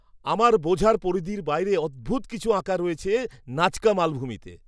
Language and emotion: Bengali, surprised